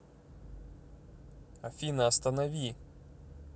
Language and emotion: Russian, neutral